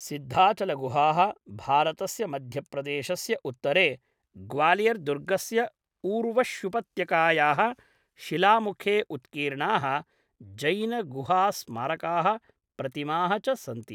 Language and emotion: Sanskrit, neutral